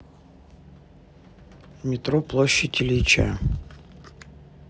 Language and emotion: Russian, neutral